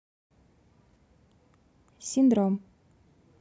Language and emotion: Russian, neutral